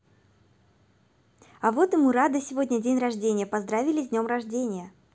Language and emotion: Russian, positive